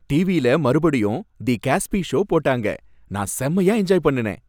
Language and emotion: Tamil, happy